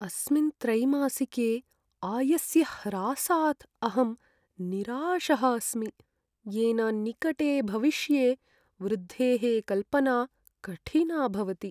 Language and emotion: Sanskrit, sad